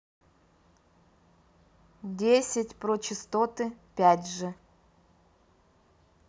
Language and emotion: Russian, neutral